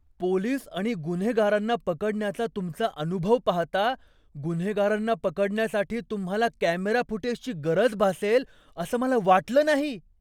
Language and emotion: Marathi, surprised